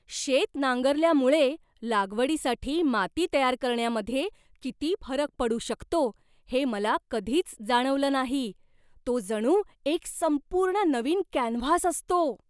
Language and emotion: Marathi, surprised